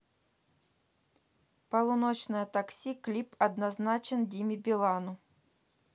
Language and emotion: Russian, neutral